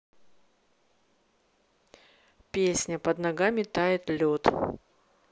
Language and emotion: Russian, neutral